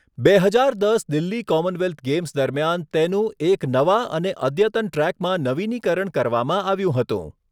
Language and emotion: Gujarati, neutral